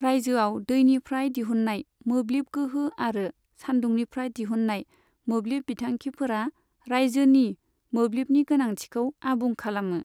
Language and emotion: Bodo, neutral